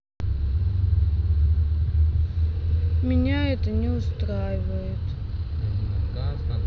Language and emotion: Russian, sad